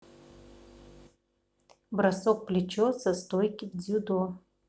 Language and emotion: Russian, neutral